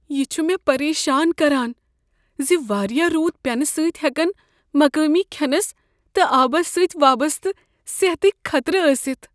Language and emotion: Kashmiri, fearful